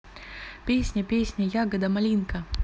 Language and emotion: Russian, neutral